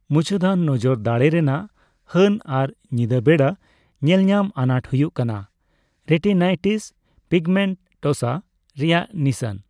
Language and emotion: Santali, neutral